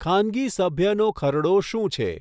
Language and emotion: Gujarati, neutral